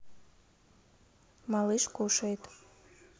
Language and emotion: Russian, neutral